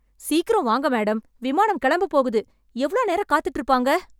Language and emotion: Tamil, angry